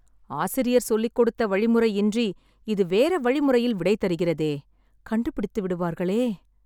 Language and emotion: Tamil, sad